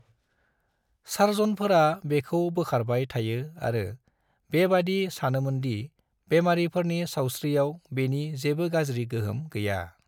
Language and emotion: Bodo, neutral